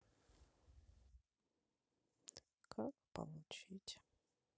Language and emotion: Russian, sad